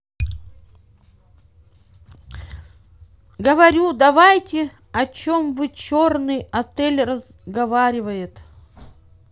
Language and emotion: Russian, neutral